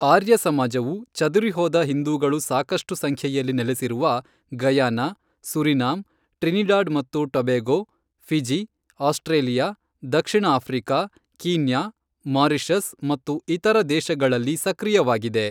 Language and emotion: Kannada, neutral